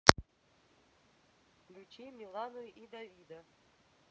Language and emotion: Russian, neutral